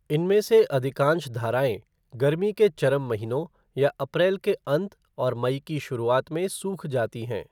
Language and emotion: Hindi, neutral